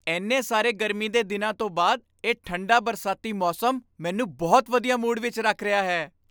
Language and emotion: Punjabi, happy